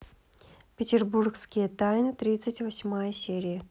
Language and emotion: Russian, neutral